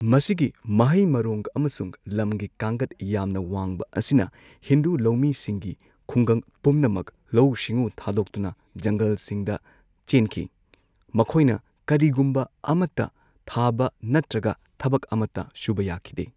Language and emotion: Manipuri, neutral